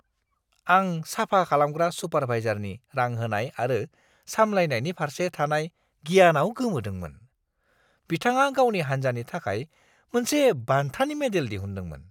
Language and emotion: Bodo, surprised